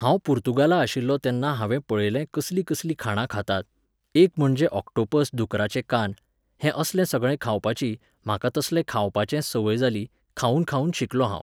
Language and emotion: Goan Konkani, neutral